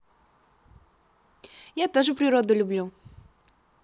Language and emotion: Russian, positive